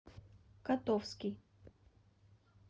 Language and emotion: Russian, neutral